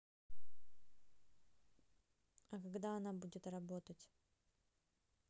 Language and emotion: Russian, neutral